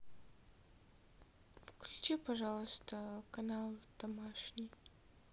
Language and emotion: Russian, sad